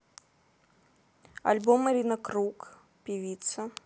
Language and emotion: Russian, neutral